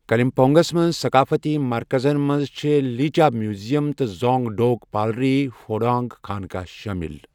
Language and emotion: Kashmiri, neutral